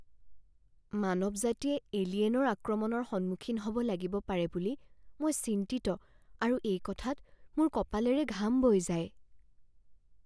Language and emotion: Assamese, fearful